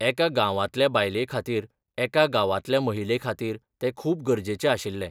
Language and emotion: Goan Konkani, neutral